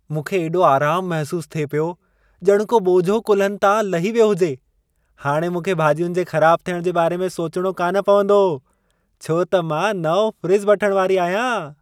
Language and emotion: Sindhi, happy